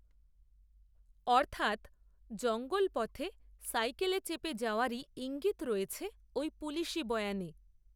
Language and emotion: Bengali, neutral